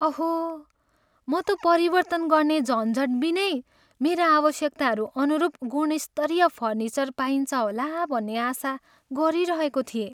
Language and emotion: Nepali, sad